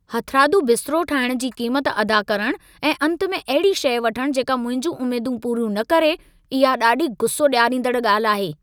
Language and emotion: Sindhi, angry